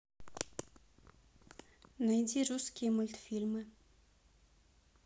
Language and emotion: Russian, neutral